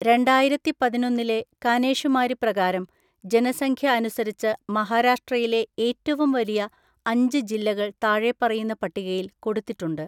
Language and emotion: Malayalam, neutral